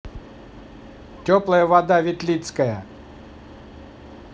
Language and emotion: Russian, neutral